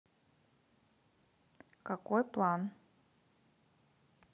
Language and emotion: Russian, neutral